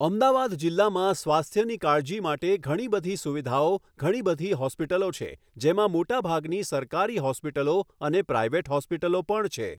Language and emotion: Gujarati, neutral